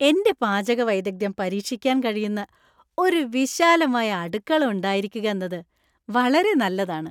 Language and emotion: Malayalam, happy